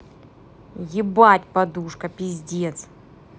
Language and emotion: Russian, angry